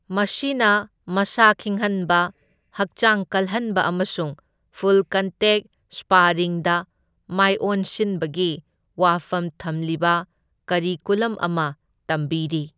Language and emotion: Manipuri, neutral